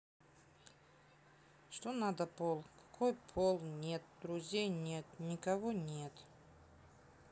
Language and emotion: Russian, sad